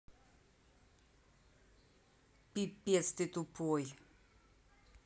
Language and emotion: Russian, angry